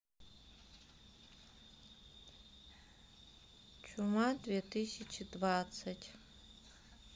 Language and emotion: Russian, sad